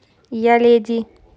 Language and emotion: Russian, neutral